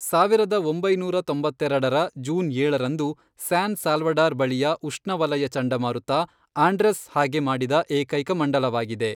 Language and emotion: Kannada, neutral